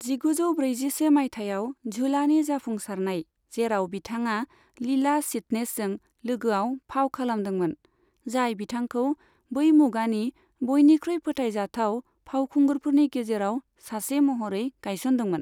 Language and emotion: Bodo, neutral